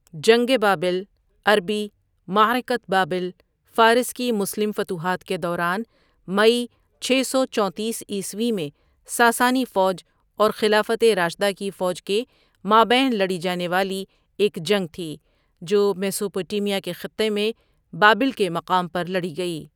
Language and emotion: Urdu, neutral